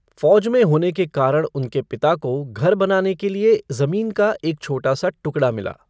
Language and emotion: Hindi, neutral